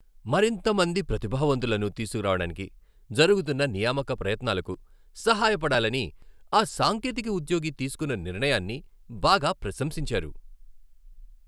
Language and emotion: Telugu, happy